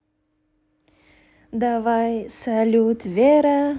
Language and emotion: Russian, positive